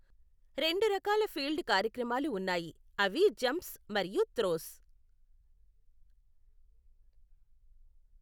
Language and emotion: Telugu, neutral